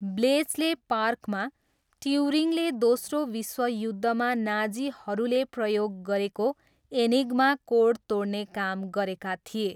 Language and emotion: Nepali, neutral